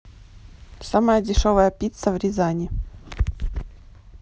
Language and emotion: Russian, neutral